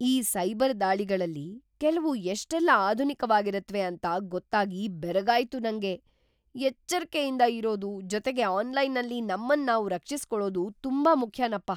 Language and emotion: Kannada, surprised